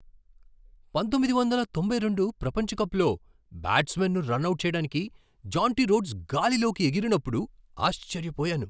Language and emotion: Telugu, surprised